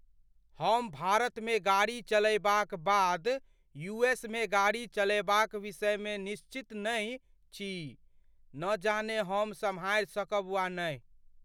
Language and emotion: Maithili, fearful